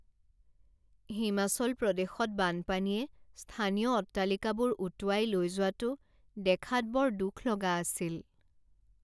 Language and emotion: Assamese, sad